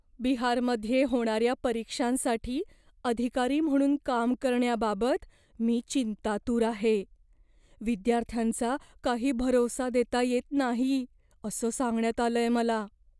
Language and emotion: Marathi, fearful